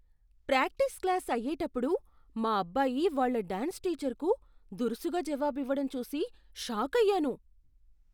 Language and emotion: Telugu, surprised